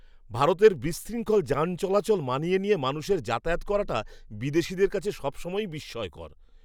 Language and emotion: Bengali, surprised